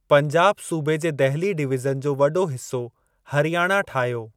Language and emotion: Sindhi, neutral